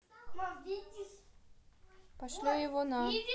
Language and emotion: Russian, neutral